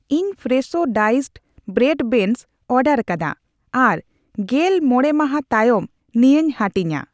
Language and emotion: Santali, neutral